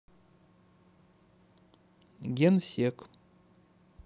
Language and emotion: Russian, neutral